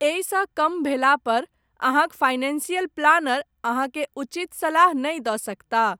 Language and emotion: Maithili, neutral